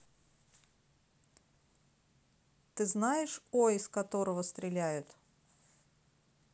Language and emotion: Russian, neutral